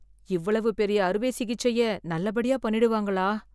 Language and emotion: Tamil, fearful